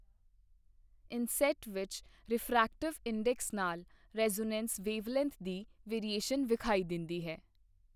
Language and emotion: Punjabi, neutral